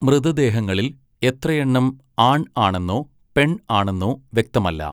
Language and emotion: Malayalam, neutral